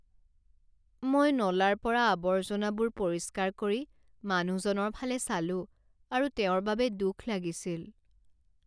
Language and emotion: Assamese, sad